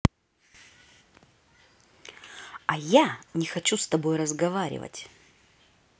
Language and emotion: Russian, neutral